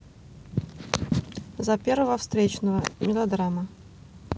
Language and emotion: Russian, neutral